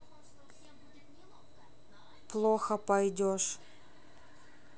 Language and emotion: Russian, neutral